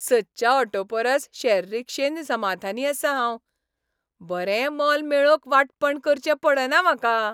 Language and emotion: Goan Konkani, happy